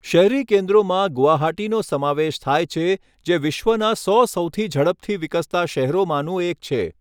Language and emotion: Gujarati, neutral